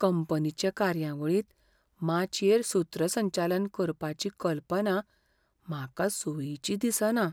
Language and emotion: Goan Konkani, fearful